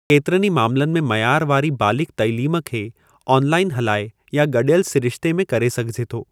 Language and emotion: Sindhi, neutral